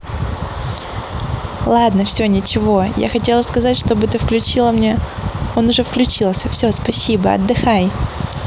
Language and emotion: Russian, positive